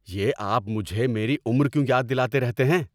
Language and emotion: Urdu, angry